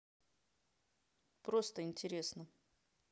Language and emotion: Russian, neutral